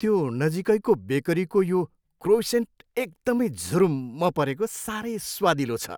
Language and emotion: Nepali, happy